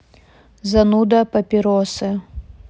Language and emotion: Russian, sad